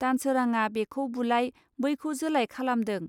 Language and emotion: Bodo, neutral